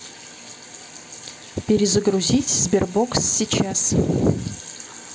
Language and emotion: Russian, neutral